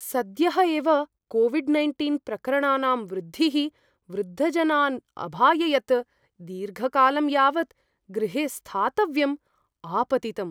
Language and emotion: Sanskrit, fearful